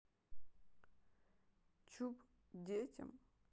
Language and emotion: Russian, neutral